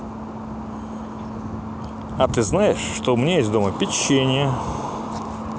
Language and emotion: Russian, positive